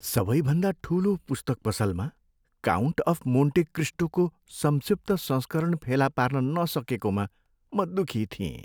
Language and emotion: Nepali, sad